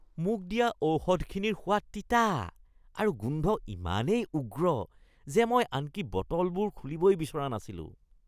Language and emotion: Assamese, disgusted